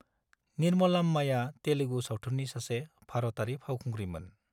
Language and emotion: Bodo, neutral